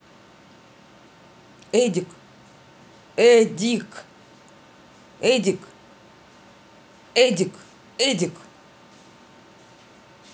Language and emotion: Russian, neutral